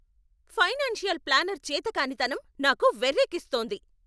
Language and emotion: Telugu, angry